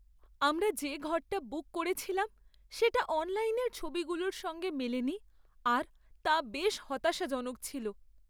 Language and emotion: Bengali, sad